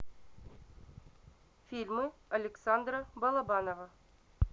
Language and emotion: Russian, neutral